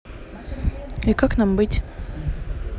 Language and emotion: Russian, neutral